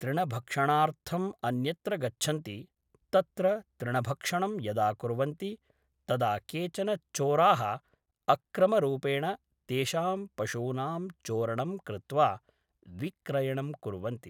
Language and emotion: Sanskrit, neutral